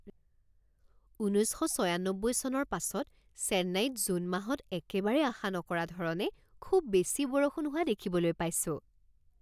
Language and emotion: Assamese, surprised